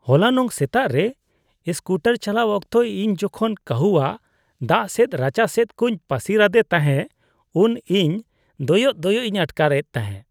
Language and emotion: Santali, disgusted